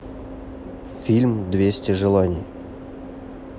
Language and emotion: Russian, neutral